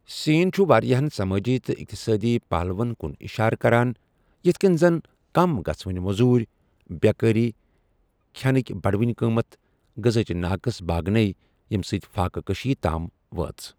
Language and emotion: Kashmiri, neutral